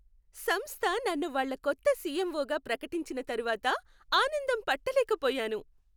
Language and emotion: Telugu, happy